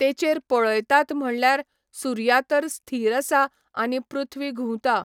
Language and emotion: Goan Konkani, neutral